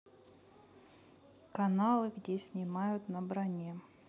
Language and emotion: Russian, neutral